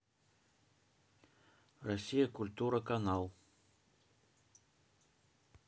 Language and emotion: Russian, neutral